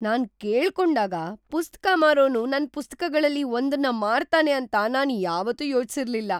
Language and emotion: Kannada, surprised